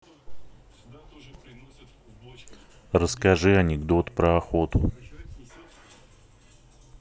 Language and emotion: Russian, neutral